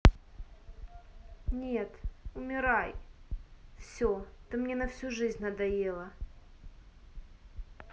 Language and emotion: Russian, angry